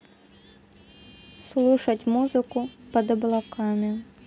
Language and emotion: Russian, neutral